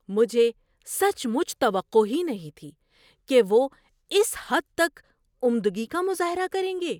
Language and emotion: Urdu, surprised